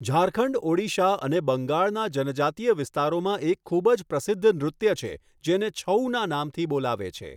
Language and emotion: Gujarati, neutral